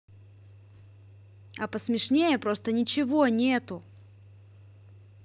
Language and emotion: Russian, angry